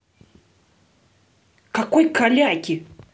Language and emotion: Russian, angry